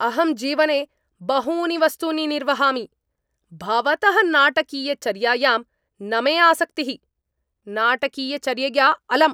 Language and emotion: Sanskrit, angry